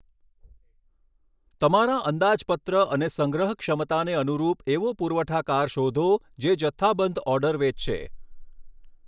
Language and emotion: Gujarati, neutral